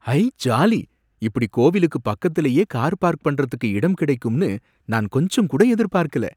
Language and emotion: Tamil, surprised